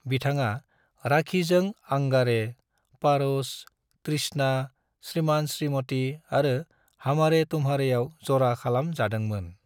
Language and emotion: Bodo, neutral